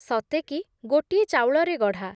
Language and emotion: Odia, neutral